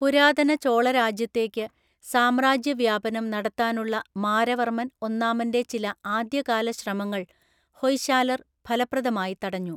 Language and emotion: Malayalam, neutral